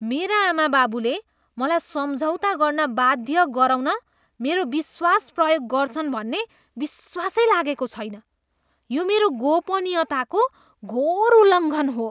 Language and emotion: Nepali, disgusted